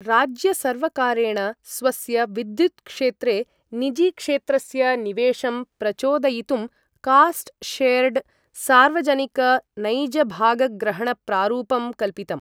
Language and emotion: Sanskrit, neutral